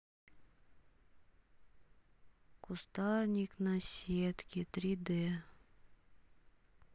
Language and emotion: Russian, sad